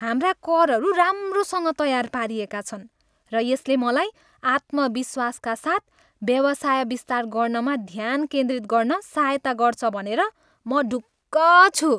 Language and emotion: Nepali, happy